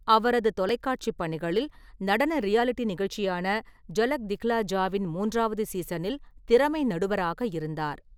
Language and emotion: Tamil, neutral